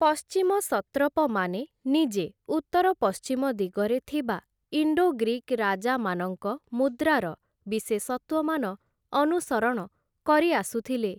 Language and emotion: Odia, neutral